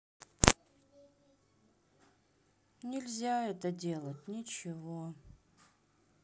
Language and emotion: Russian, sad